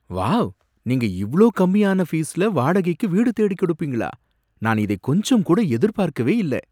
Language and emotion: Tamil, surprised